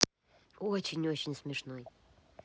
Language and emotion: Russian, positive